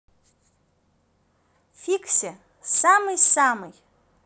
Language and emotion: Russian, positive